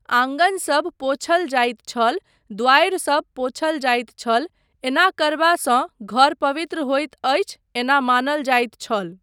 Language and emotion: Maithili, neutral